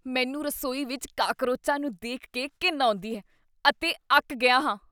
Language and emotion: Punjabi, disgusted